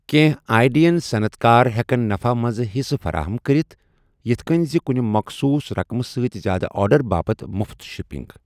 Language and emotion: Kashmiri, neutral